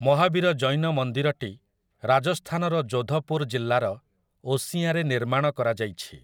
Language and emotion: Odia, neutral